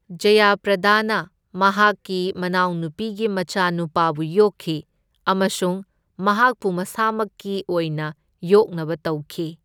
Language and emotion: Manipuri, neutral